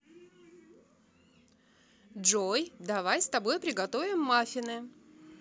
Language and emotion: Russian, positive